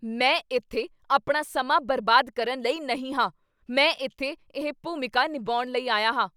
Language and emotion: Punjabi, angry